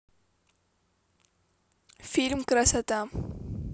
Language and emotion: Russian, neutral